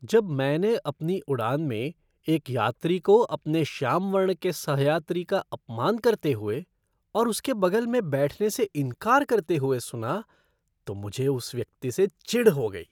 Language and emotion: Hindi, disgusted